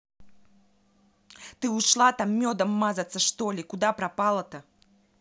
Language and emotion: Russian, angry